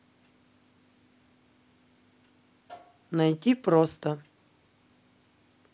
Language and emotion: Russian, neutral